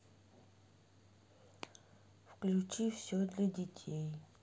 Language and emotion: Russian, sad